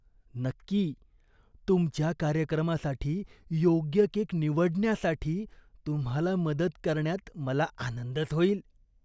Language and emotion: Marathi, disgusted